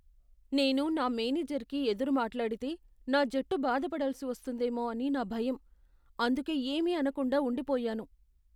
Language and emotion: Telugu, fearful